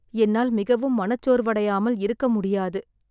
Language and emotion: Tamil, sad